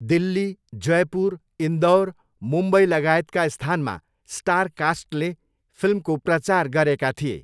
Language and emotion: Nepali, neutral